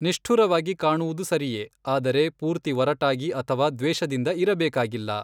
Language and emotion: Kannada, neutral